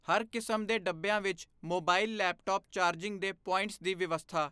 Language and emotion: Punjabi, neutral